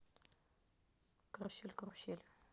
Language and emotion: Russian, neutral